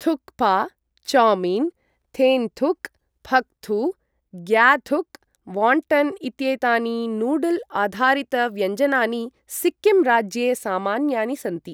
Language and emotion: Sanskrit, neutral